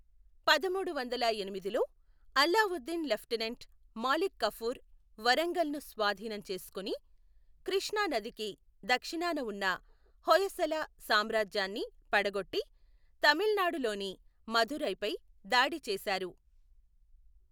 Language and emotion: Telugu, neutral